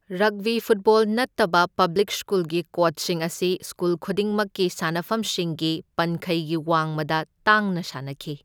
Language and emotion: Manipuri, neutral